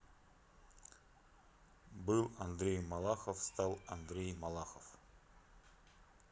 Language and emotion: Russian, neutral